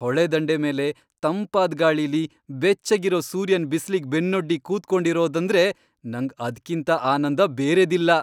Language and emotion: Kannada, happy